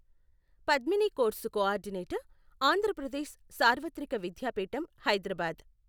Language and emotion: Telugu, neutral